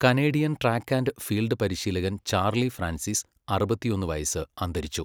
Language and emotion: Malayalam, neutral